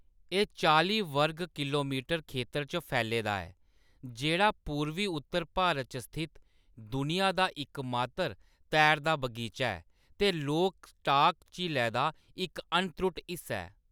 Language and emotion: Dogri, neutral